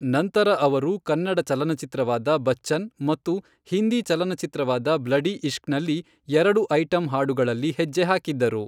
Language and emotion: Kannada, neutral